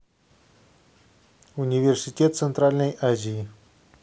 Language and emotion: Russian, neutral